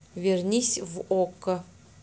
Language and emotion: Russian, neutral